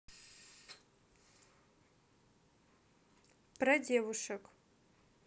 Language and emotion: Russian, neutral